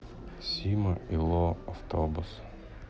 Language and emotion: Russian, sad